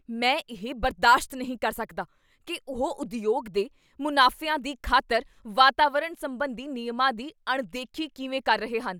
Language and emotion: Punjabi, angry